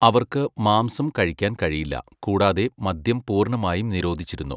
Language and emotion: Malayalam, neutral